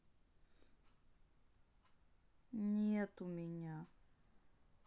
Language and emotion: Russian, sad